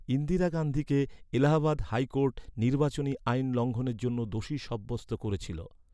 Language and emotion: Bengali, neutral